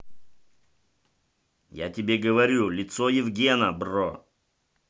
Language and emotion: Russian, angry